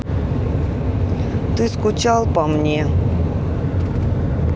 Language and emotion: Russian, sad